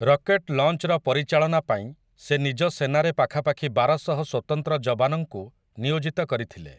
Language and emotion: Odia, neutral